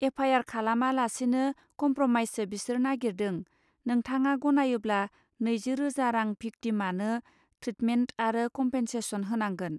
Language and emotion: Bodo, neutral